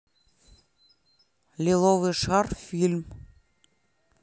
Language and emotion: Russian, neutral